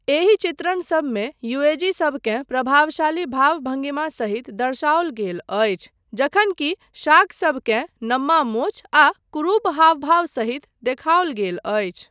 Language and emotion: Maithili, neutral